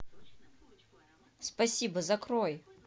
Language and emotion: Russian, neutral